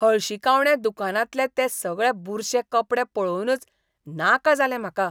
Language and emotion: Goan Konkani, disgusted